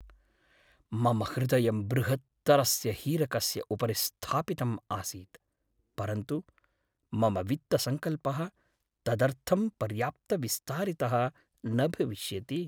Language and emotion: Sanskrit, sad